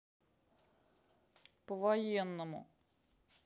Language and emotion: Russian, sad